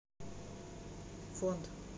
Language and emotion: Russian, neutral